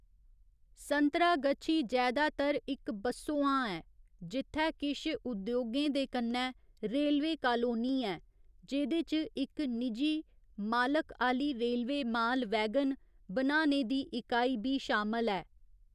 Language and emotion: Dogri, neutral